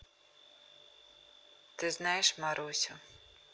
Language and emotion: Russian, neutral